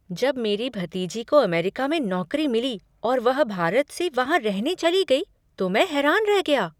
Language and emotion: Hindi, surprised